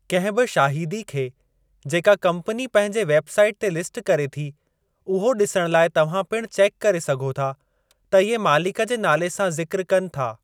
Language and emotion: Sindhi, neutral